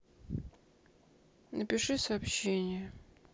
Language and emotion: Russian, sad